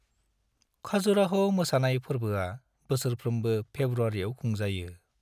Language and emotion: Bodo, neutral